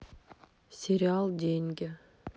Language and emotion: Russian, neutral